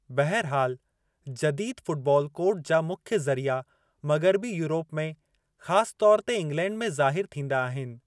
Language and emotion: Sindhi, neutral